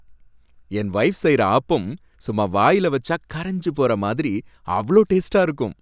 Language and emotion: Tamil, happy